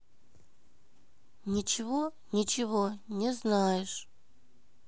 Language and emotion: Russian, neutral